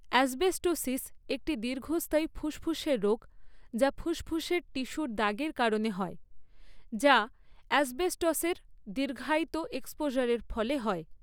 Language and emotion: Bengali, neutral